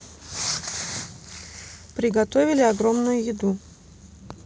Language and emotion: Russian, neutral